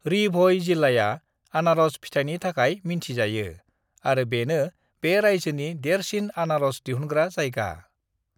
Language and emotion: Bodo, neutral